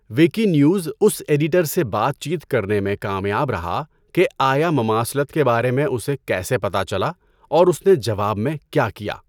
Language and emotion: Urdu, neutral